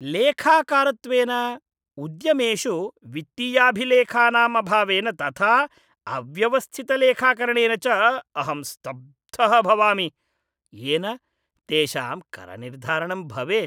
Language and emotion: Sanskrit, disgusted